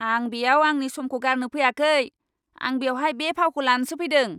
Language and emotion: Bodo, angry